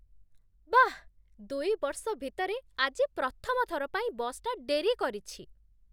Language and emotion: Odia, surprised